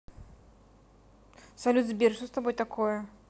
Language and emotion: Russian, neutral